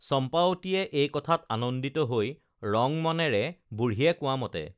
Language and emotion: Assamese, neutral